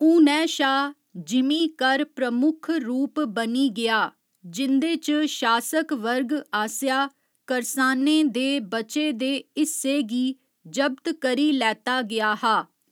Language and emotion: Dogri, neutral